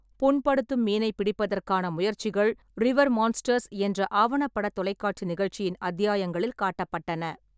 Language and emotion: Tamil, neutral